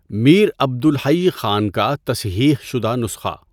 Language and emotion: Urdu, neutral